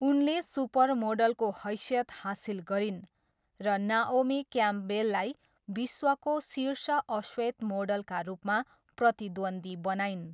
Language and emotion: Nepali, neutral